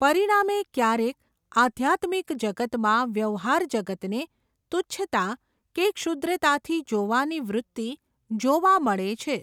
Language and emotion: Gujarati, neutral